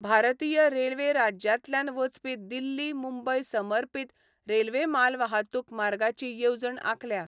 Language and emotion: Goan Konkani, neutral